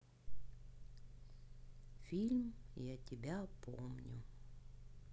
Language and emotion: Russian, sad